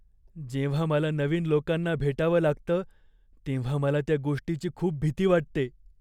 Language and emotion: Marathi, fearful